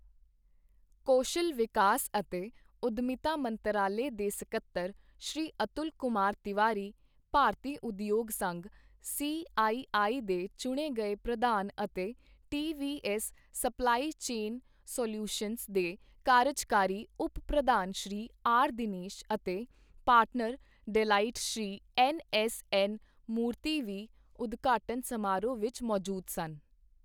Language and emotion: Punjabi, neutral